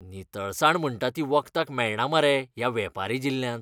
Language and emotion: Goan Konkani, disgusted